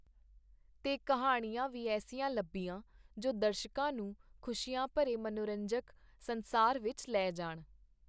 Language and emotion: Punjabi, neutral